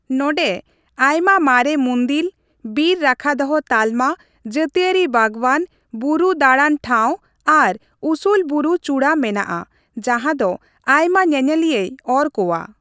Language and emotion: Santali, neutral